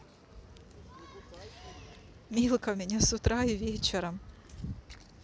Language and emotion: Russian, positive